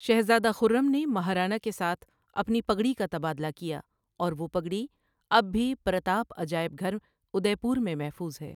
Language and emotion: Urdu, neutral